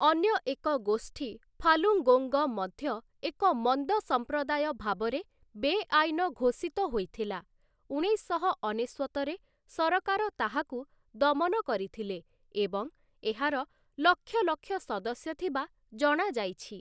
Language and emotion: Odia, neutral